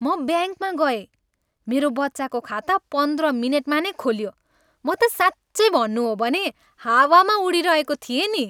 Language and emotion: Nepali, happy